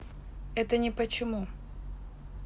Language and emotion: Russian, neutral